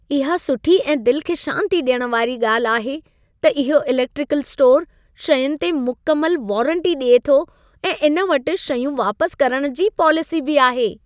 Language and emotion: Sindhi, happy